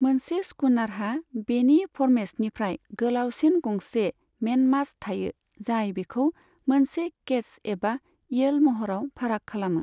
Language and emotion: Bodo, neutral